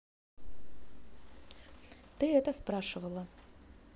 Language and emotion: Russian, neutral